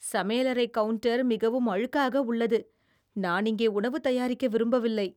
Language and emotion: Tamil, disgusted